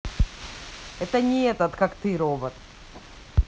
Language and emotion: Russian, angry